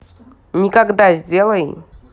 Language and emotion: Russian, neutral